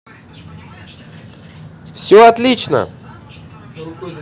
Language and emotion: Russian, positive